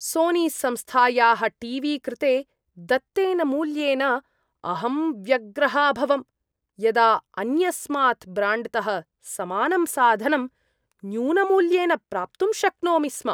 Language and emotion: Sanskrit, disgusted